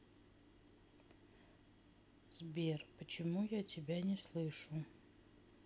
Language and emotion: Russian, sad